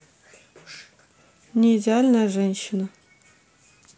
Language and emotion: Russian, neutral